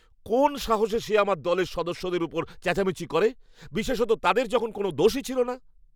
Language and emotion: Bengali, angry